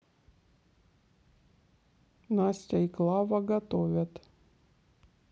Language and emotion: Russian, neutral